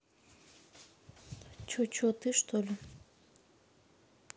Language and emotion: Russian, neutral